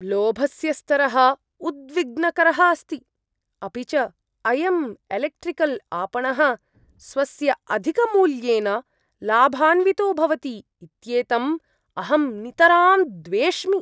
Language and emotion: Sanskrit, disgusted